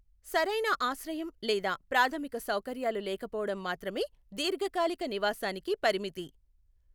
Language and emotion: Telugu, neutral